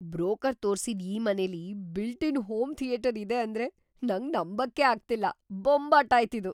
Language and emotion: Kannada, surprised